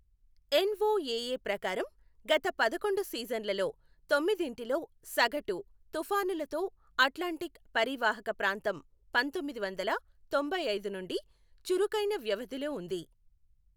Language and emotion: Telugu, neutral